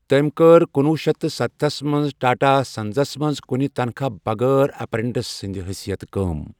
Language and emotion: Kashmiri, neutral